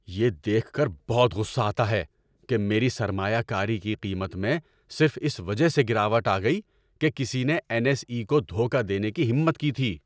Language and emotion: Urdu, angry